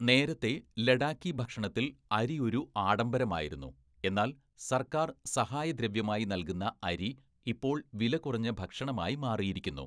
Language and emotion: Malayalam, neutral